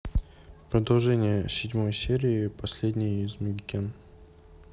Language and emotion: Russian, neutral